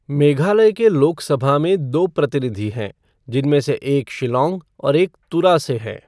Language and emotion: Hindi, neutral